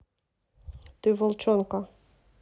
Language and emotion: Russian, neutral